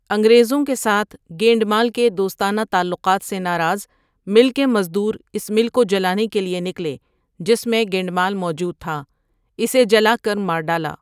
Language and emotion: Urdu, neutral